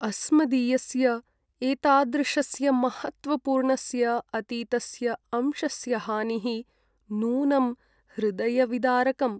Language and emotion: Sanskrit, sad